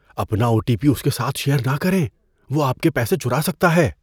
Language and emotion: Urdu, fearful